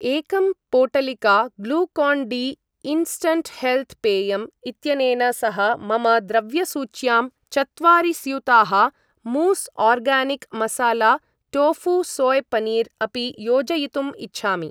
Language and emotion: Sanskrit, neutral